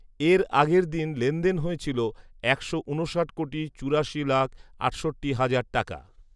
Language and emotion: Bengali, neutral